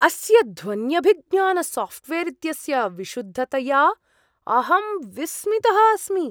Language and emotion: Sanskrit, surprised